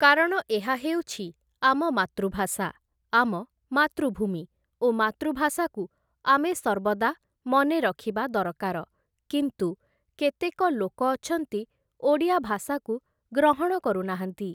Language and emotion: Odia, neutral